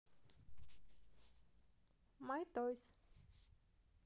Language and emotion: Russian, positive